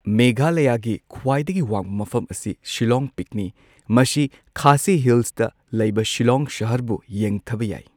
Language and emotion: Manipuri, neutral